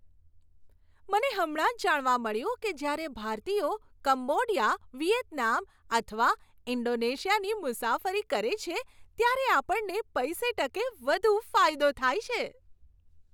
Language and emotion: Gujarati, happy